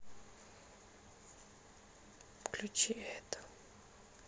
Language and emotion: Russian, sad